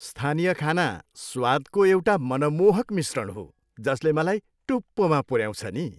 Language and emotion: Nepali, happy